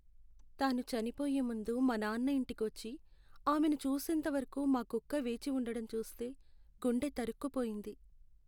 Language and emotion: Telugu, sad